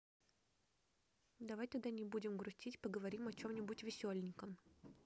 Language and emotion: Russian, neutral